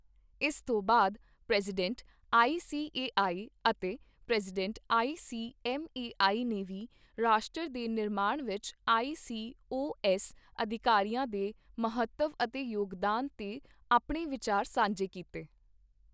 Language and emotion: Punjabi, neutral